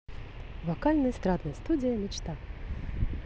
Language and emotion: Russian, positive